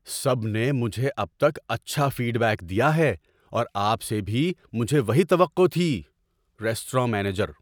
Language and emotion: Urdu, surprised